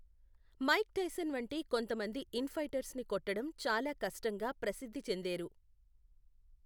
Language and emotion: Telugu, neutral